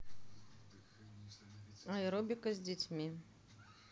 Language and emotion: Russian, neutral